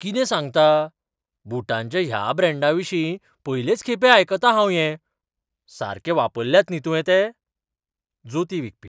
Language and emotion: Goan Konkani, surprised